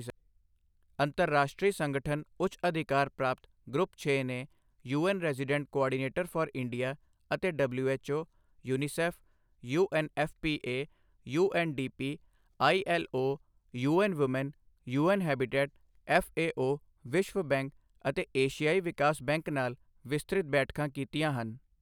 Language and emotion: Punjabi, neutral